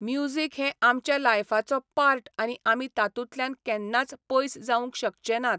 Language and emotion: Goan Konkani, neutral